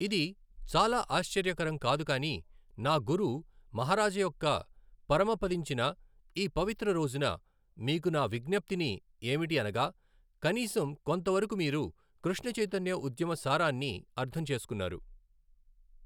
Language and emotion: Telugu, neutral